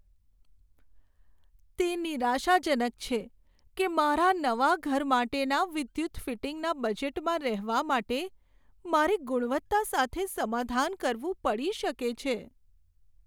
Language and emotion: Gujarati, sad